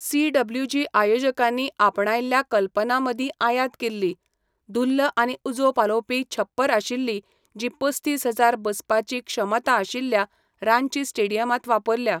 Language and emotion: Goan Konkani, neutral